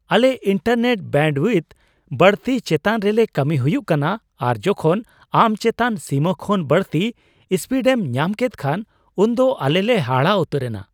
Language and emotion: Santali, surprised